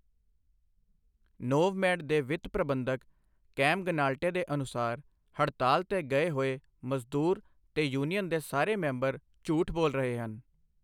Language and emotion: Punjabi, neutral